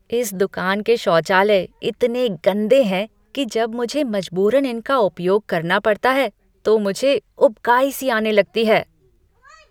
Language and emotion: Hindi, disgusted